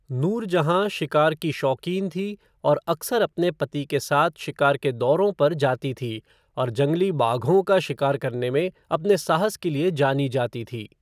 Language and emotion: Hindi, neutral